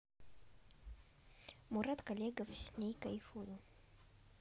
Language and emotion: Russian, neutral